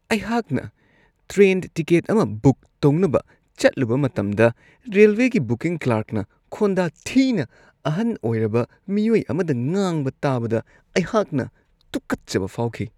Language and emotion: Manipuri, disgusted